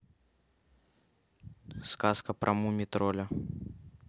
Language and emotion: Russian, neutral